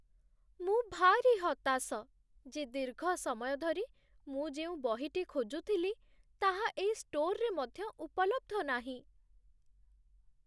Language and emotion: Odia, sad